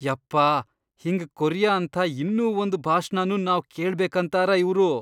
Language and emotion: Kannada, disgusted